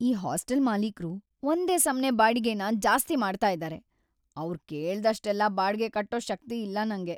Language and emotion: Kannada, sad